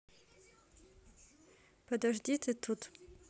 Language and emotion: Russian, neutral